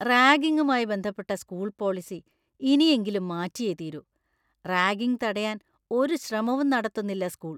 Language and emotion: Malayalam, disgusted